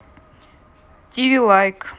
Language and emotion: Russian, neutral